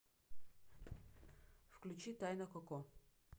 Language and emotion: Russian, neutral